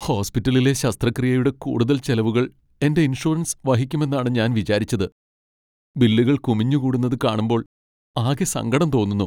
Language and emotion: Malayalam, sad